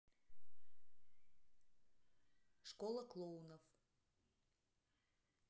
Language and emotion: Russian, neutral